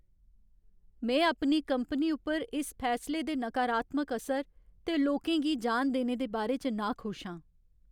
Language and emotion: Dogri, sad